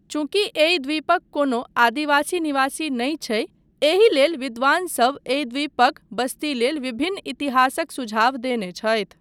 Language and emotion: Maithili, neutral